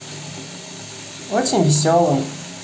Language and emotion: Russian, positive